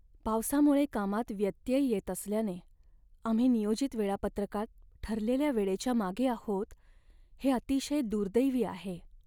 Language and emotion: Marathi, sad